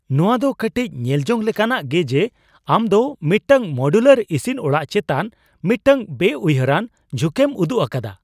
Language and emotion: Santali, surprised